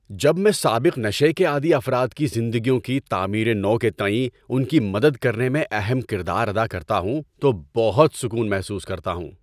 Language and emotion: Urdu, happy